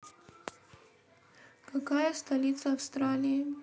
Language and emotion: Russian, neutral